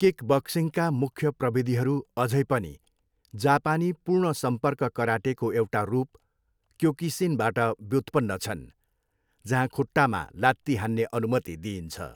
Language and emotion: Nepali, neutral